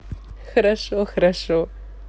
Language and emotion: Russian, positive